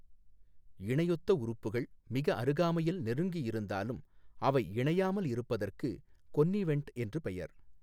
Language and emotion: Tamil, neutral